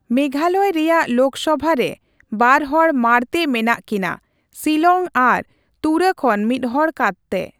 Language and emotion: Santali, neutral